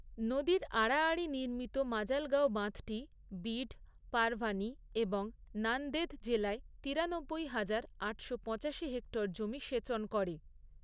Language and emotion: Bengali, neutral